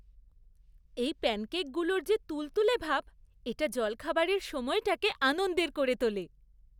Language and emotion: Bengali, happy